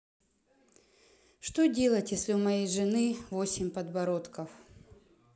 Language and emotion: Russian, sad